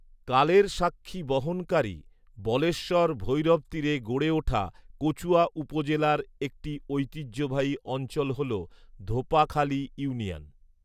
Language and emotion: Bengali, neutral